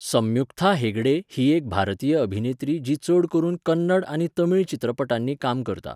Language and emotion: Goan Konkani, neutral